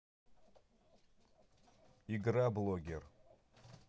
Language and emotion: Russian, neutral